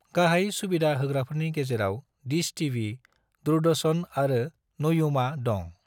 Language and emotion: Bodo, neutral